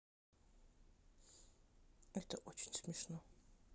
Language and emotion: Russian, neutral